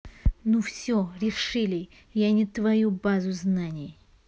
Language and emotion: Russian, angry